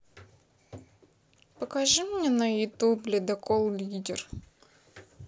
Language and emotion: Russian, neutral